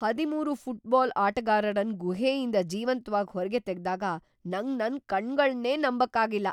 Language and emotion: Kannada, surprised